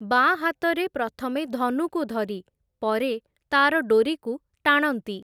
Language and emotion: Odia, neutral